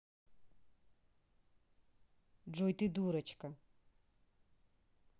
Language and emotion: Russian, neutral